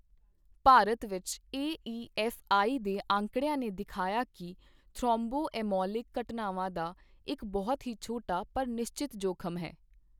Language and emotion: Punjabi, neutral